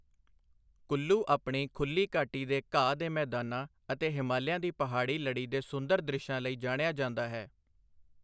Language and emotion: Punjabi, neutral